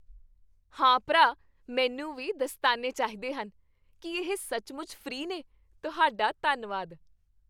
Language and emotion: Punjabi, happy